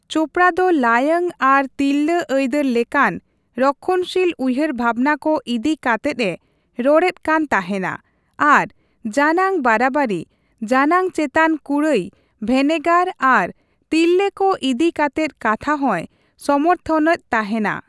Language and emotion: Santali, neutral